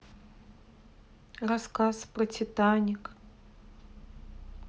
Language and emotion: Russian, sad